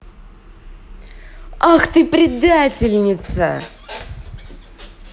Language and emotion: Russian, angry